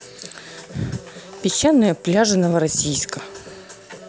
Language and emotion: Russian, neutral